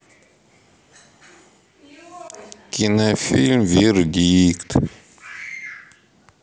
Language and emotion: Russian, neutral